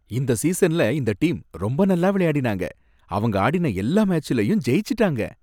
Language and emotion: Tamil, happy